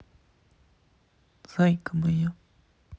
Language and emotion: Russian, sad